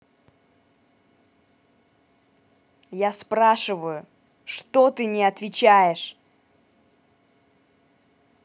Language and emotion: Russian, angry